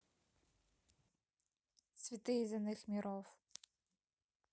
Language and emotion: Russian, neutral